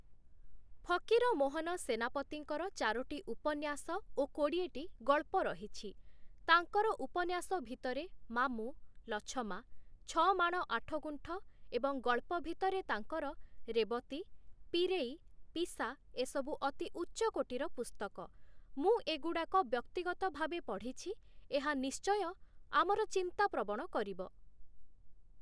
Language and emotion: Odia, neutral